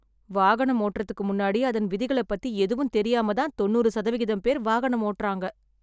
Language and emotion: Tamil, sad